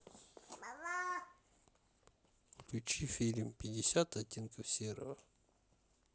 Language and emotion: Russian, neutral